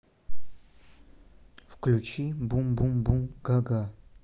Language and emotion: Russian, neutral